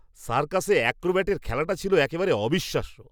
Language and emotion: Bengali, surprised